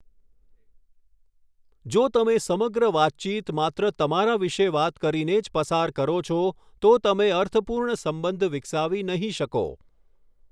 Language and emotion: Gujarati, neutral